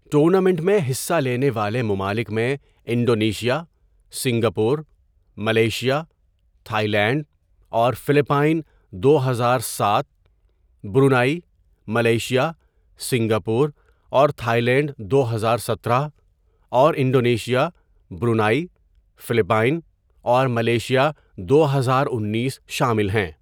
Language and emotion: Urdu, neutral